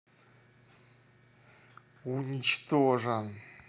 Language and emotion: Russian, angry